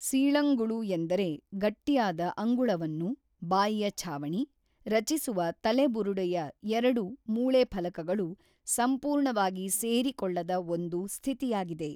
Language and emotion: Kannada, neutral